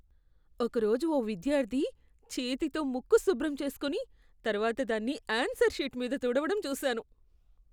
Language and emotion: Telugu, disgusted